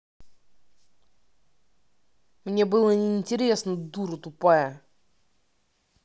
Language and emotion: Russian, angry